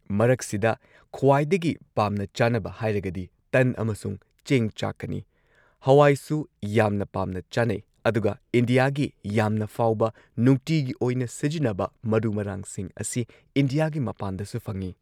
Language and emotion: Manipuri, neutral